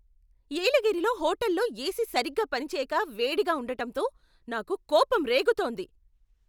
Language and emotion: Telugu, angry